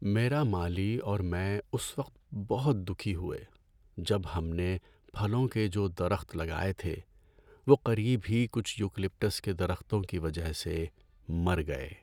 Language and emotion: Urdu, sad